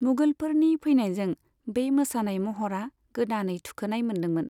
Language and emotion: Bodo, neutral